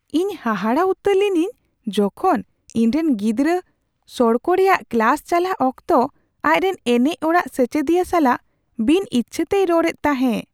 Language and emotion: Santali, surprised